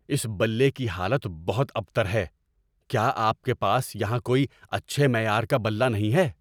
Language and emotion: Urdu, angry